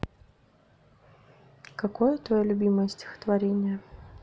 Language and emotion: Russian, neutral